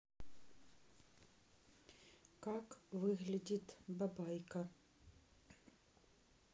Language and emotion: Russian, neutral